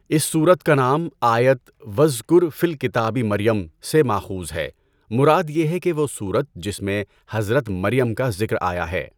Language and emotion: Urdu, neutral